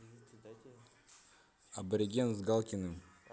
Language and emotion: Russian, neutral